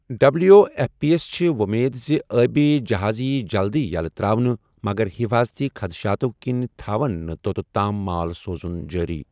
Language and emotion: Kashmiri, neutral